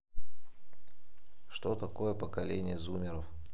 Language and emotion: Russian, neutral